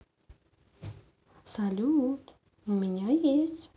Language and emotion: Russian, positive